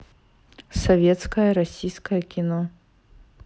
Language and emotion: Russian, neutral